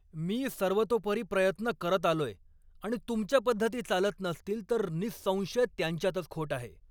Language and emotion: Marathi, angry